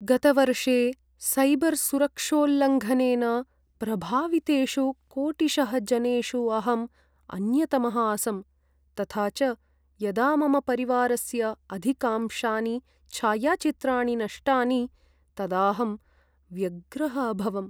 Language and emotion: Sanskrit, sad